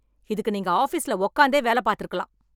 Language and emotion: Tamil, angry